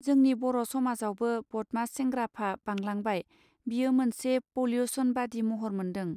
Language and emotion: Bodo, neutral